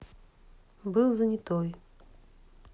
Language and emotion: Russian, neutral